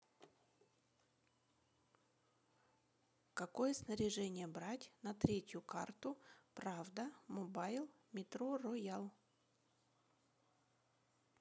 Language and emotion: Russian, neutral